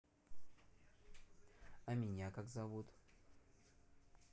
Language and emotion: Russian, neutral